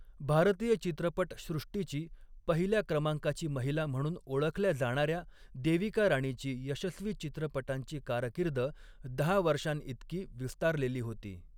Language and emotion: Marathi, neutral